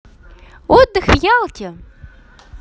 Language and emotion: Russian, positive